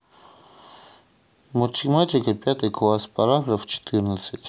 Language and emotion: Russian, neutral